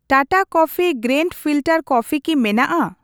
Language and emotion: Santali, neutral